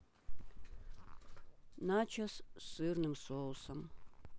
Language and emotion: Russian, neutral